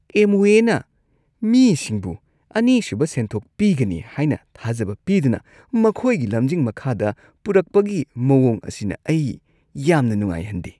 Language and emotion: Manipuri, disgusted